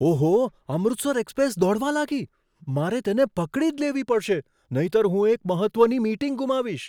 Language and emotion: Gujarati, surprised